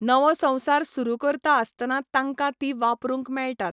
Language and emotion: Goan Konkani, neutral